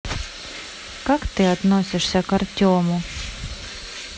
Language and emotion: Russian, neutral